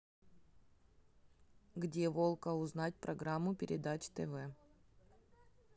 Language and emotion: Russian, neutral